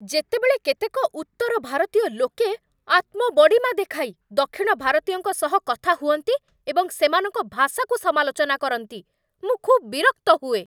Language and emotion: Odia, angry